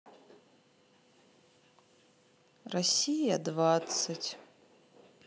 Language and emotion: Russian, sad